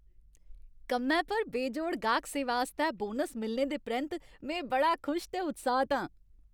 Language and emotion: Dogri, happy